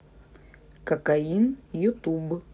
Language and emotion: Russian, neutral